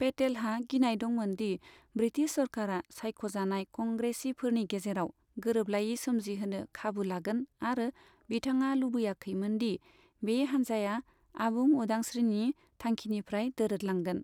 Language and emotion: Bodo, neutral